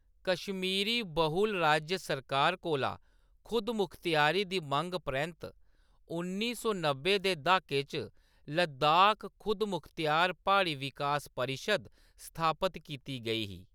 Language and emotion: Dogri, neutral